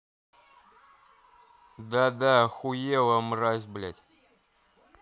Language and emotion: Russian, angry